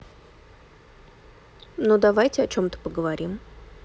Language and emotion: Russian, neutral